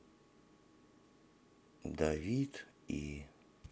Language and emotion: Russian, sad